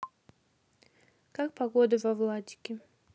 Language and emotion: Russian, neutral